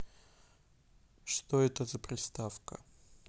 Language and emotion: Russian, neutral